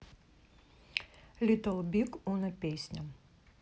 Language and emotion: Russian, neutral